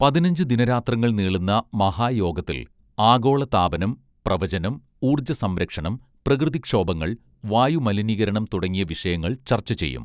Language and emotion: Malayalam, neutral